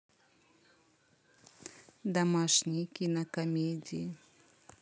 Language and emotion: Russian, neutral